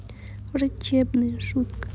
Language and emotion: Russian, sad